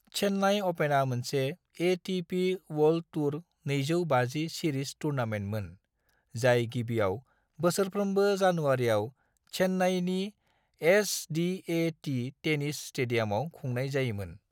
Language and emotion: Bodo, neutral